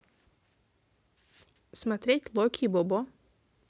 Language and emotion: Russian, neutral